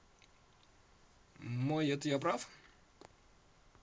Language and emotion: Russian, neutral